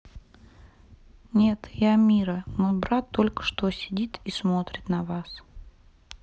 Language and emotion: Russian, sad